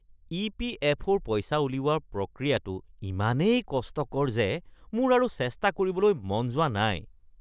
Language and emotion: Assamese, disgusted